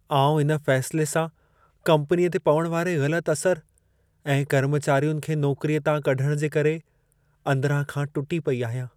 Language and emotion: Sindhi, sad